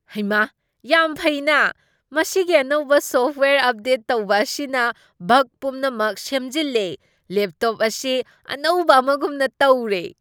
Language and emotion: Manipuri, surprised